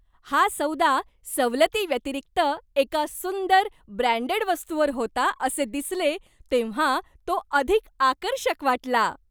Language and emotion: Marathi, happy